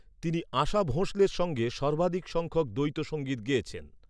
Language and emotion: Bengali, neutral